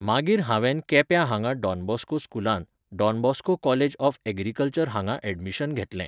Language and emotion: Goan Konkani, neutral